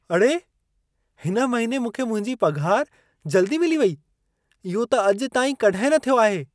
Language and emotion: Sindhi, surprised